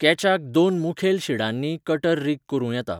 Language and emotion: Goan Konkani, neutral